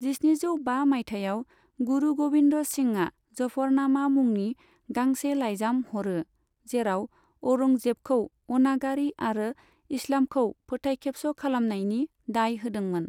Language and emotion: Bodo, neutral